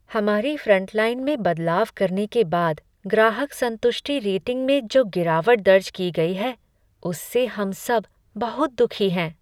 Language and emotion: Hindi, sad